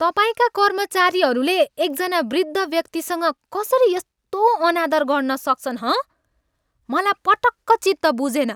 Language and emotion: Nepali, angry